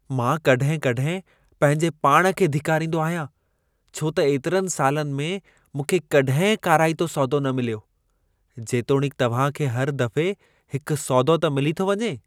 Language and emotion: Sindhi, disgusted